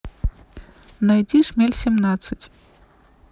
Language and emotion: Russian, neutral